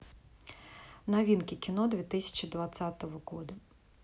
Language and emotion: Russian, neutral